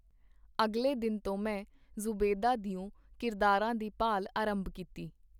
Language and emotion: Punjabi, neutral